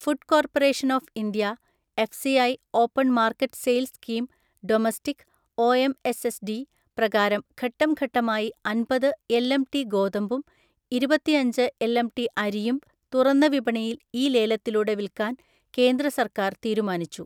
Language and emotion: Malayalam, neutral